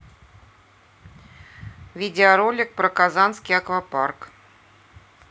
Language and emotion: Russian, neutral